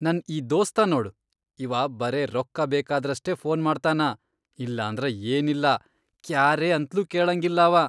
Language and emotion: Kannada, disgusted